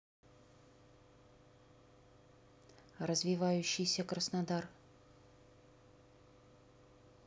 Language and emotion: Russian, neutral